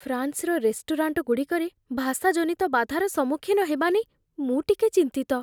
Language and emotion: Odia, fearful